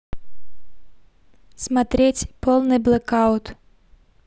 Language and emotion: Russian, neutral